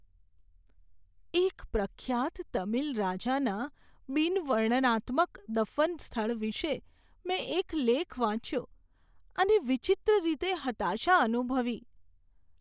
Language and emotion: Gujarati, sad